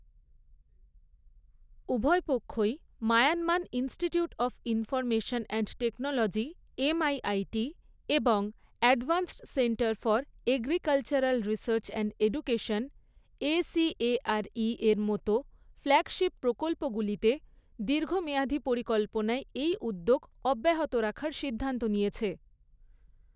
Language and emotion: Bengali, neutral